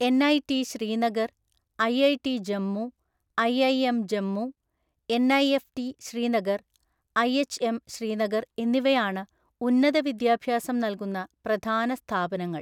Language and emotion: Malayalam, neutral